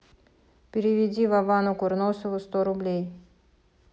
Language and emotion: Russian, neutral